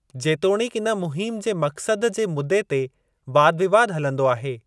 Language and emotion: Sindhi, neutral